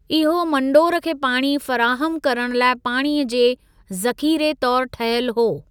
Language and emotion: Sindhi, neutral